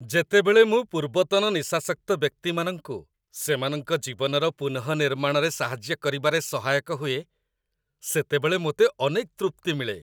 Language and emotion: Odia, happy